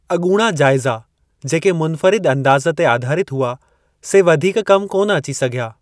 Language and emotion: Sindhi, neutral